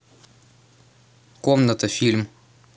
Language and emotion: Russian, neutral